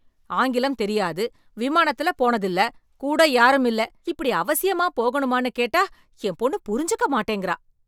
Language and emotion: Tamil, angry